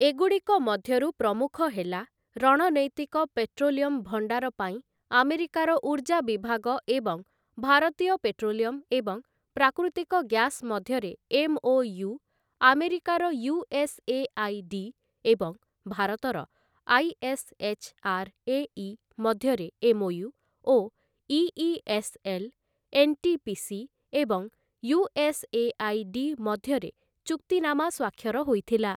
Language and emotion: Odia, neutral